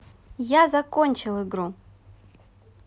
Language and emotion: Russian, positive